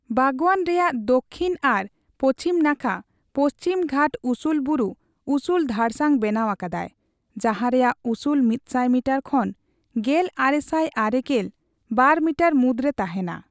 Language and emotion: Santali, neutral